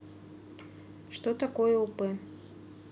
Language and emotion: Russian, neutral